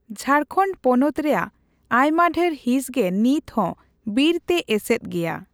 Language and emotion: Santali, neutral